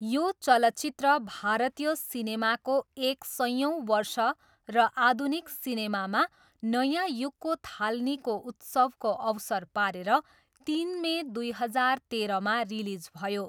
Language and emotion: Nepali, neutral